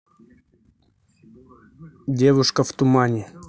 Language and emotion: Russian, neutral